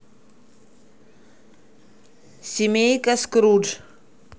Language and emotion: Russian, neutral